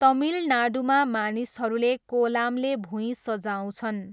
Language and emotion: Nepali, neutral